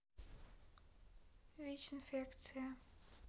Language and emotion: Russian, neutral